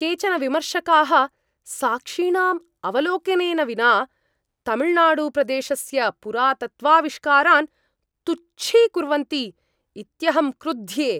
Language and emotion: Sanskrit, angry